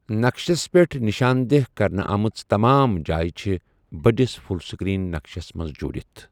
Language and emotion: Kashmiri, neutral